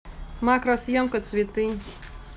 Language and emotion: Russian, neutral